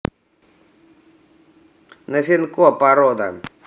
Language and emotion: Russian, neutral